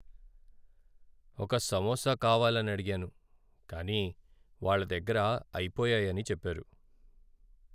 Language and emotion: Telugu, sad